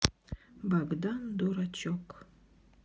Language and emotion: Russian, neutral